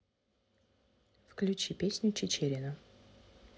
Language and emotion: Russian, neutral